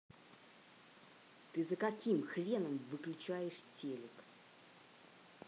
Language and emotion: Russian, angry